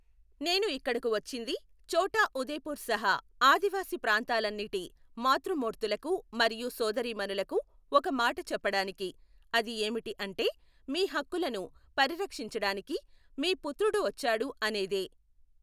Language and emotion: Telugu, neutral